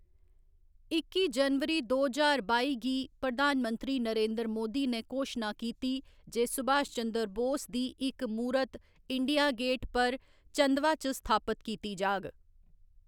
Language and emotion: Dogri, neutral